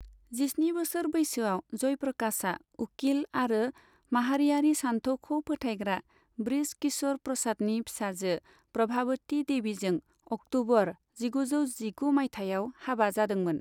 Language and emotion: Bodo, neutral